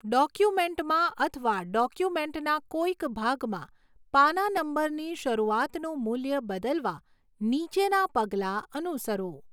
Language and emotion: Gujarati, neutral